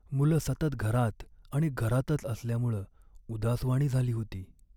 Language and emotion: Marathi, sad